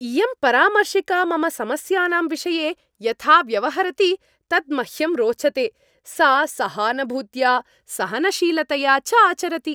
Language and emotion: Sanskrit, happy